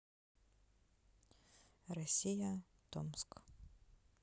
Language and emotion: Russian, neutral